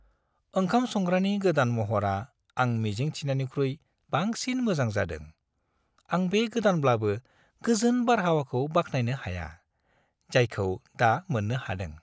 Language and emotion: Bodo, happy